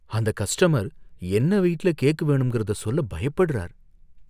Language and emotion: Tamil, fearful